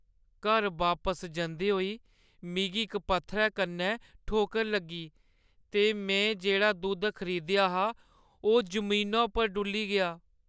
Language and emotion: Dogri, sad